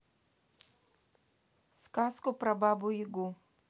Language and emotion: Russian, neutral